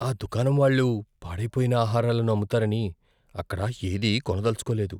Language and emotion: Telugu, fearful